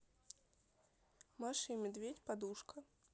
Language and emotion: Russian, neutral